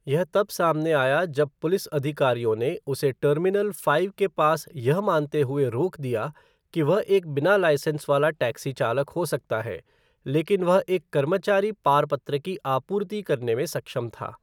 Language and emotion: Hindi, neutral